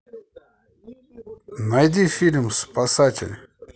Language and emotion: Russian, positive